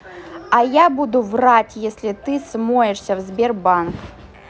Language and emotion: Russian, angry